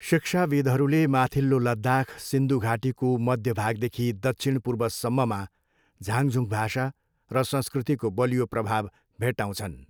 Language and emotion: Nepali, neutral